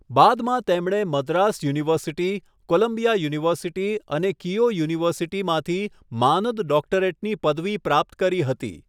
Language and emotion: Gujarati, neutral